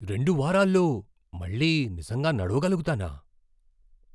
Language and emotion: Telugu, surprised